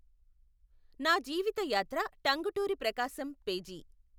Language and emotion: Telugu, neutral